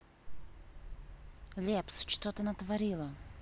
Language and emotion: Russian, angry